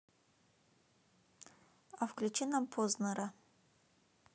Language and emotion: Russian, neutral